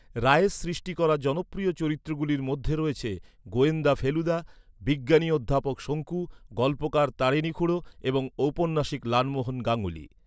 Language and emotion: Bengali, neutral